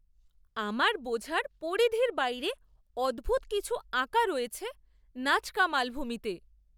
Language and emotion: Bengali, surprised